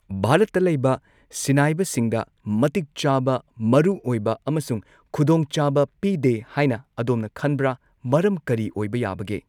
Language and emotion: Manipuri, neutral